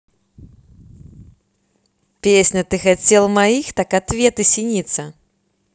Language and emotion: Russian, neutral